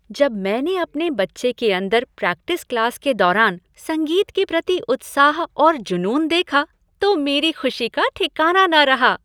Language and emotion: Hindi, happy